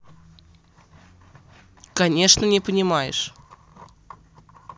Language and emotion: Russian, neutral